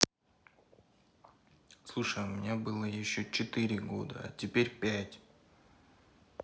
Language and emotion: Russian, neutral